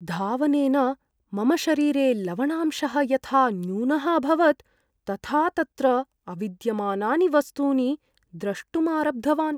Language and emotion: Sanskrit, fearful